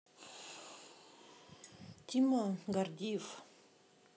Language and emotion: Russian, neutral